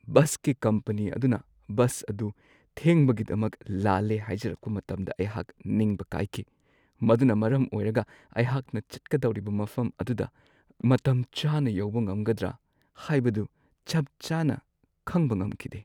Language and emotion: Manipuri, sad